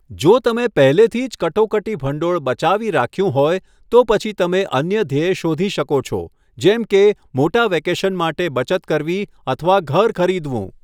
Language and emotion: Gujarati, neutral